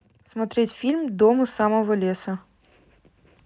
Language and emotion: Russian, neutral